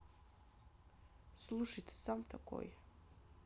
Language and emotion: Russian, neutral